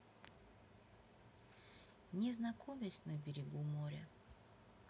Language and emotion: Russian, neutral